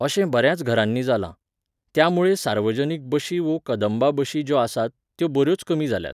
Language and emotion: Goan Konkani, neutral